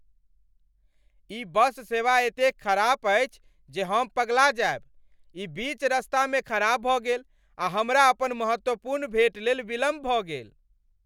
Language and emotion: Maithili, angry